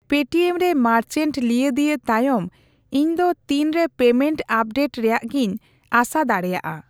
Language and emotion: Santali, neutral